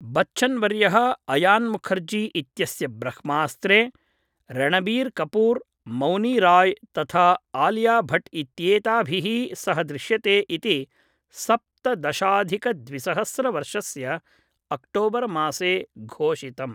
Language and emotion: Sanskrit, neutral